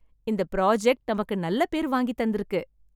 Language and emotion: Tamil, happy